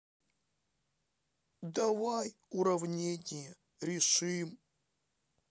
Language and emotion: Russian, sad